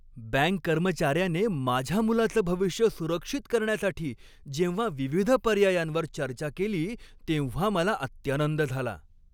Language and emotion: Marathi, happy